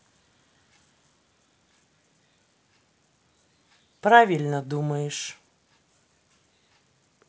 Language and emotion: Russian, neutral